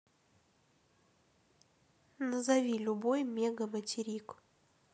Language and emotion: Russian, neutral